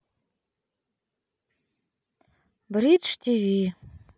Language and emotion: Russian, sad